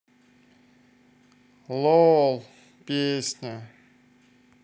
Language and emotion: Russian, sad